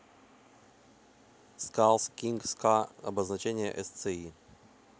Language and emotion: Russian, neutral